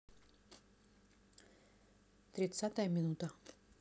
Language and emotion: Russian, neutral